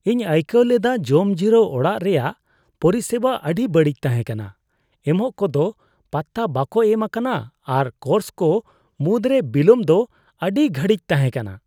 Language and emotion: Santali, disgusted